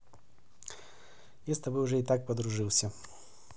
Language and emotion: Russian, positive